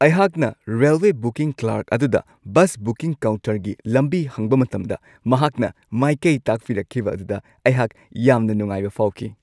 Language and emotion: Manipuri, happy